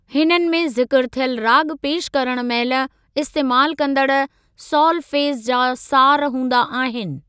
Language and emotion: Sindhi, neutral